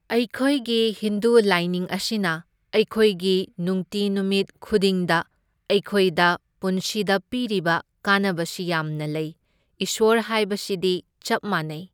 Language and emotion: Manipuri, neutral